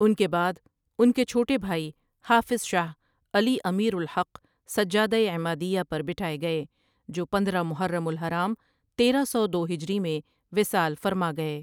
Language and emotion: Urdu, neutral